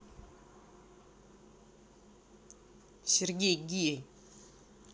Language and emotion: Russian, angry